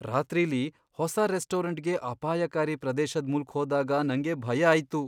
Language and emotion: Kannada, fearful